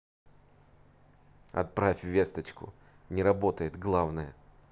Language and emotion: Russian, neutral